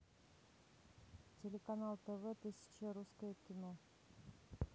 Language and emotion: Russian, neutral